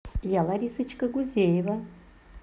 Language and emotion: Russian, positive